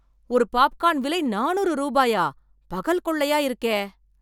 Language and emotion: Tamil, angry